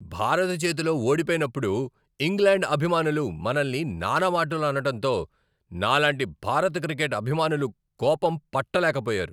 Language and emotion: Telugu, angry